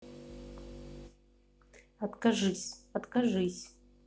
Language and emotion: Russian, neutral